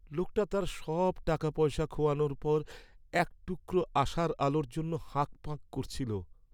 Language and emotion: Bengali, sad